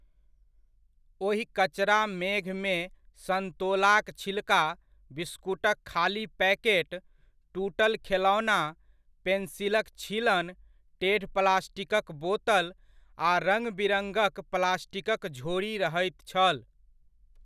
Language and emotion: Maithili, neutral